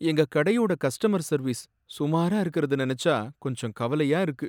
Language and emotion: Tamil, sad